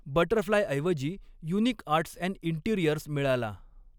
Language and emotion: Marathi, neutral